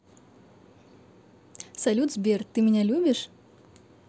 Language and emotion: Russian, positive